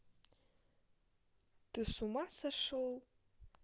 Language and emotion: Russian, neutral